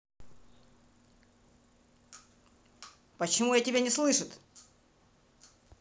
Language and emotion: Russian, angry